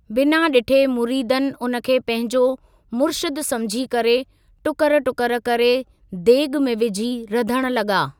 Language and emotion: Sindhi, neutral